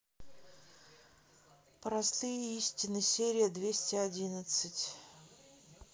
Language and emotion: Russian, neutral